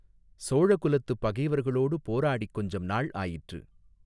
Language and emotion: Tamil, neutral